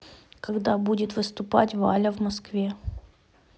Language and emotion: Russian, neutral